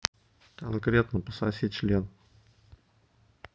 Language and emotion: Russian, neutral